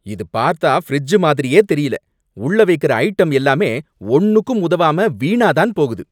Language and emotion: Tamil, angry